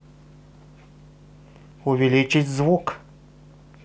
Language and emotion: Russian, positive